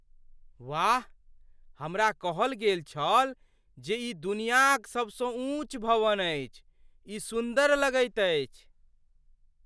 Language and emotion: Maithili, surprised